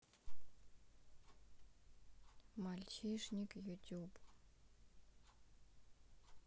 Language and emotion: Russian, sad